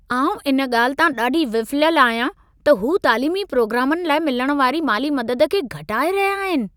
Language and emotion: Sindhi, angry